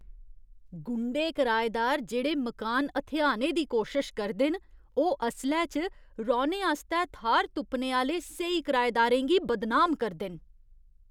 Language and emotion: Dogri, disgusted